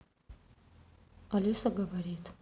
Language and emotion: Russian, neutral